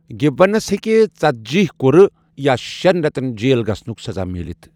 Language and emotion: Kashmiri, neutral